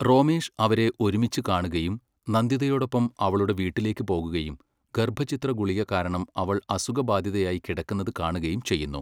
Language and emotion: Malayalam, neutral